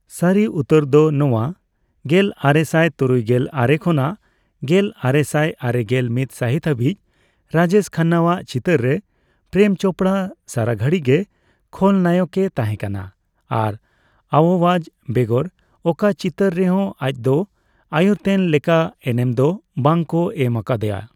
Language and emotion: Santali, neutral